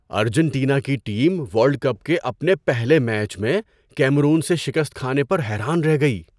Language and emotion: Urdu, surprised